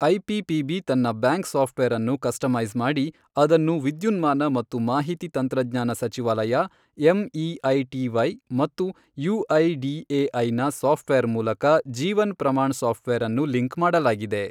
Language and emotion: Kannada, neutral